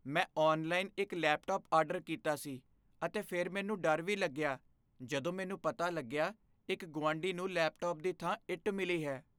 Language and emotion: Punjabi, fearful